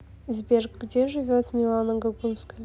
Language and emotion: Russian, neutral